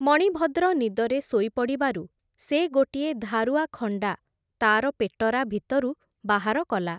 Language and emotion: Odia, neutral